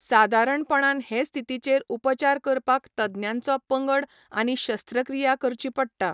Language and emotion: Goan Konkani, neutral